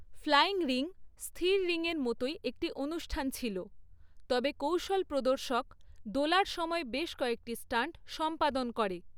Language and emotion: Bengali, neutral